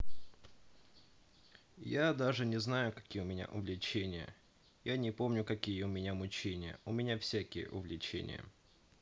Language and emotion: Russian, sad